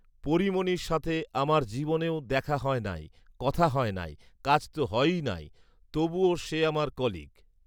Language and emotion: Bengali, neutral